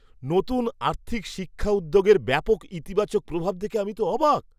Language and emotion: Bengali, surprised